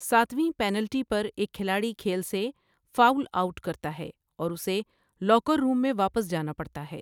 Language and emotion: Urdu, neutral